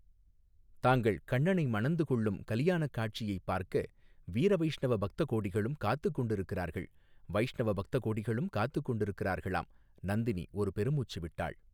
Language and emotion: Tamil, neutral